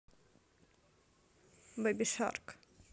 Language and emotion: Russian, neutral